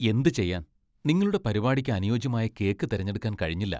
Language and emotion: Malayalam, disgusted